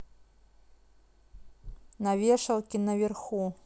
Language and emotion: Russian, neutral